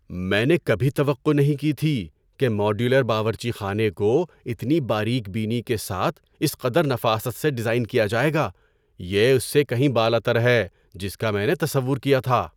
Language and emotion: Urdu, surprised